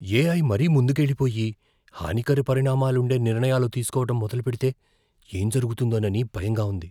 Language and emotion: Telugu, fearful